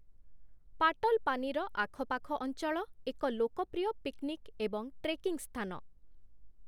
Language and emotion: Odia, neutral